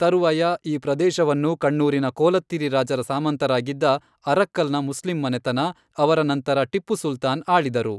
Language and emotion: Kannada, neutral